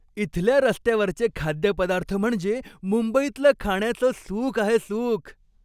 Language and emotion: Marathi, happy